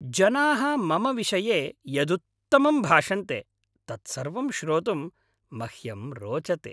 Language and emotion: Sanskrit, happy